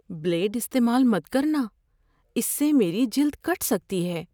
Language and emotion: Urdu, fearful